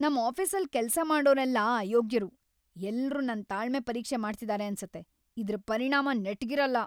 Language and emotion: Kannada, angry